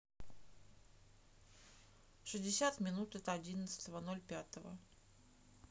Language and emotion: Russian, neutral